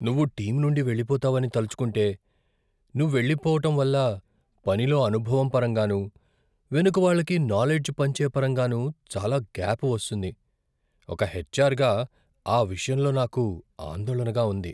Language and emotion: Telugu, fearful